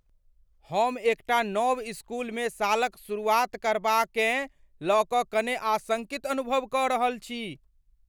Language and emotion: Maithili, fearful